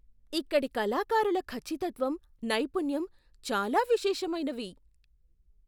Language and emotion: Telugu, surprised